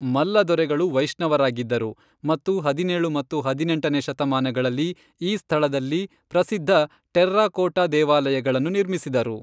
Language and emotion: Kannada, neutral